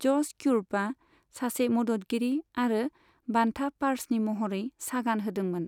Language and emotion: Bodo, neutral